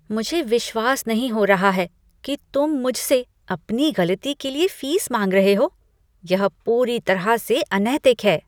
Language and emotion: Hindi, disgusted